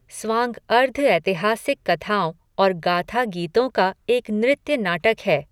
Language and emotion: Hindi, neutral